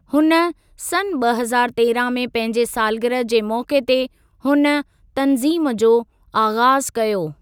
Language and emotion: Sindhi, neutral